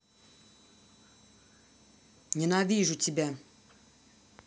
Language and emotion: Russian, angry